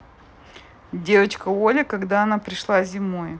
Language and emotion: Russian, neutral